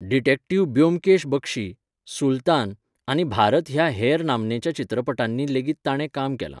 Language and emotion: Goan Konkani, neutral